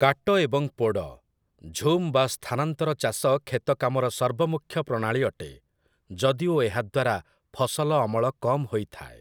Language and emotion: Odia, neutral